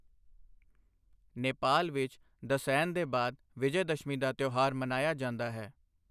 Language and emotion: Punjabi, neutral